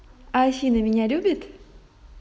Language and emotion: Russian, positive